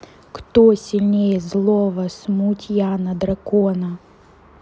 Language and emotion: Russian, neutral